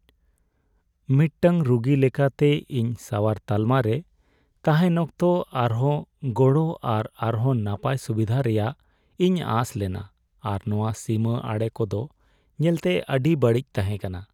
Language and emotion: Santali, sad